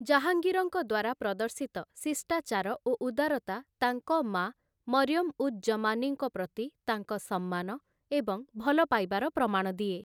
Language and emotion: Odia, neutral